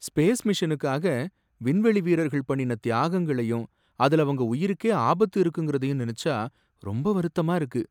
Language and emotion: Tamil, sad